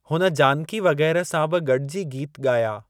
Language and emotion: Sindhi, neutral